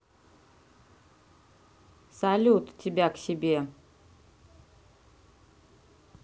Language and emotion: Russian, neutral